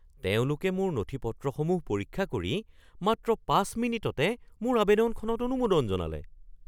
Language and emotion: Assamese, surprised